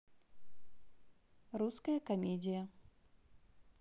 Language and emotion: Russian, neutral